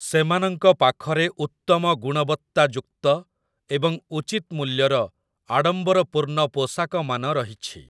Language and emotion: Odia, neutral